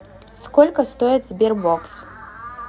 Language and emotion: Russian, neutral